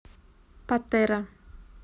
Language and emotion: Russian, neutral